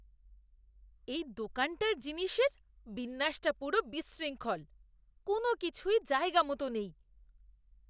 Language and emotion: Bengali, disgusted